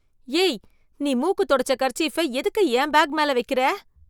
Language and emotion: Tamil, disgusted